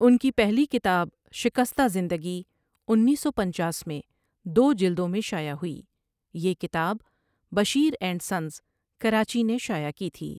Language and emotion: Urdu, neutral